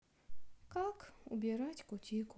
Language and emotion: Russian, sad